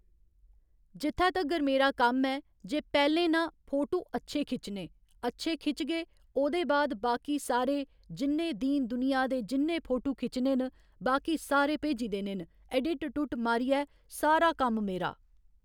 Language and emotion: Dogri, neutral